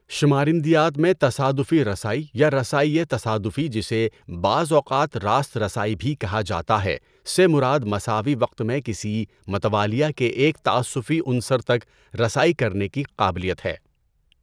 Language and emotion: Urdu, neutral